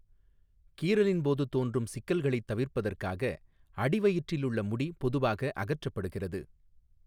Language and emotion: Tamil, neutral